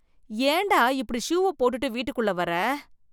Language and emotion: Tamil, disgusted